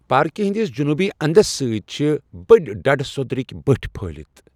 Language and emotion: Kashmiri, neutral